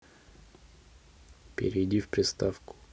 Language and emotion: Russian, neutral